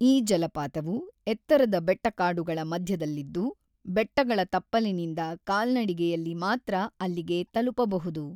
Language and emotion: Kannada, neutral